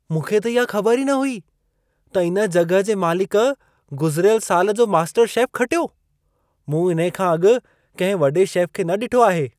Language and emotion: Sindhi, surprised